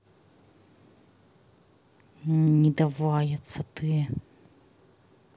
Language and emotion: Russian, angry